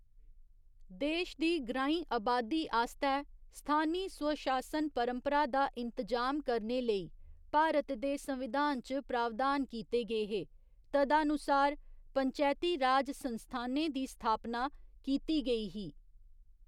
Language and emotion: Dogri, neutral